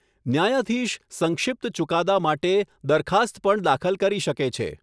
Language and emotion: Gujarati, neutral